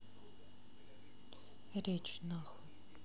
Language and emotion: Russian, neutral